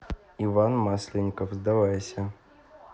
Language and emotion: Russian, neutral